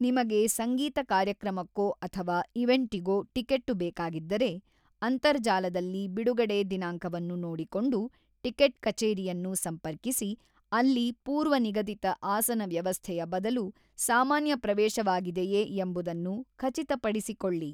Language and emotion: Kannada, neutral